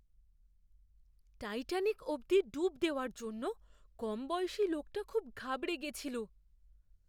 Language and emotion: Bengali, fearful